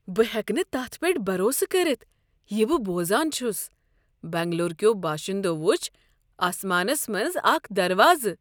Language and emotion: Kashmiri, surprised